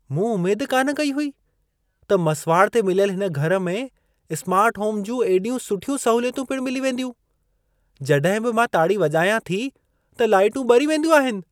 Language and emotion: Sindhi, surprised